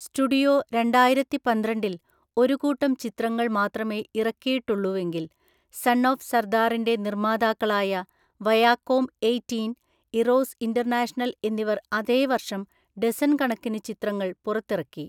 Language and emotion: Malayalam, neutral